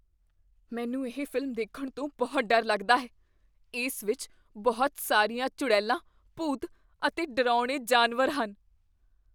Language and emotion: Punjabi, fearful